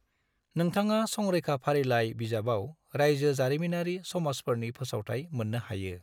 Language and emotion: Bodo, neutral